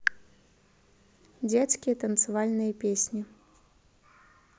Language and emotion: Russian, neutral